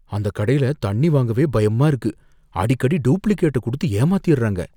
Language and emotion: Tamil, fearful